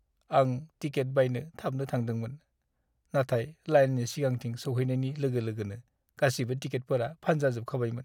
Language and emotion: Bodo, sad